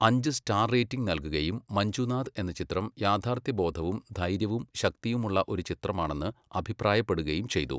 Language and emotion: Malayalam, neutral